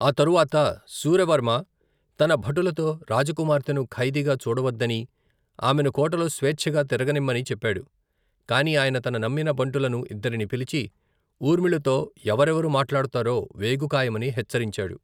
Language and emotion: Telugu, neutral